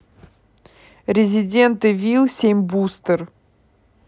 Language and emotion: Russian, neutral